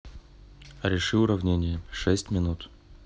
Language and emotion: Russian, neutral